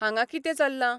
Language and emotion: Goan Konkani, neutral